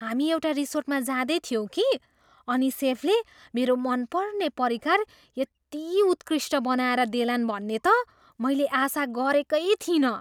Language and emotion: Nepali, surprised